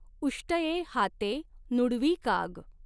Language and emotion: Marathi, neutral